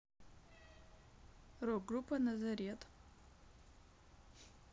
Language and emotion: Russian, neutral